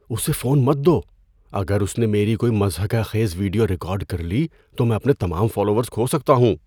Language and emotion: Urdu, fearful